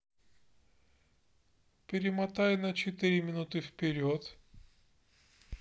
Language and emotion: Russian, neutral